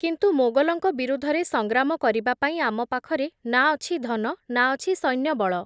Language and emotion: Odia, neutral